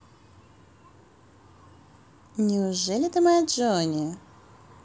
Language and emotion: Russian, positive